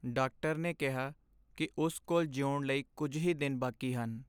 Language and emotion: Punjabi, sad